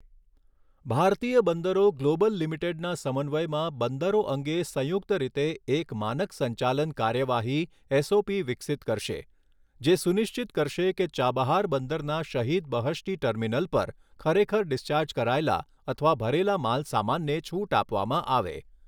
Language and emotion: Gujarati, neutral